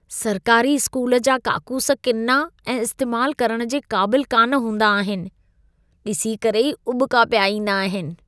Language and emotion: Sindhi, disgusted